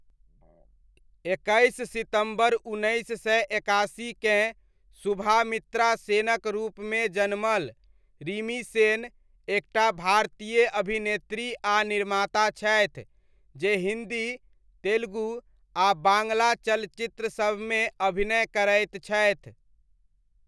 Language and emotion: Maithili, neutral